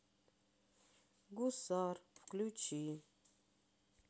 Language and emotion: Russian, sad